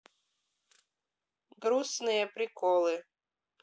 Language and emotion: Russian, neutral